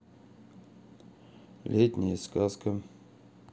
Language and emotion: Russian, neutral